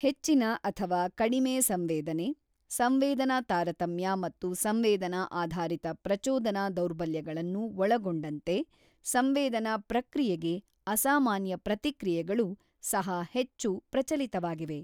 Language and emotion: Kannada, neutral